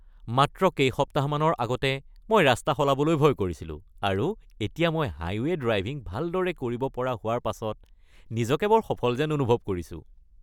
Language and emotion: Assamese, happy